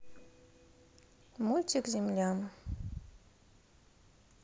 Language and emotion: Russian, neutral